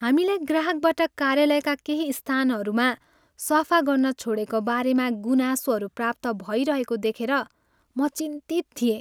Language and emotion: Nepali, sad